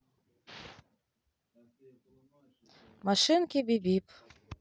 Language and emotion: Russian, neutral